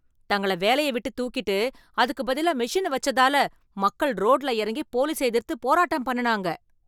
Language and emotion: Tamil, angry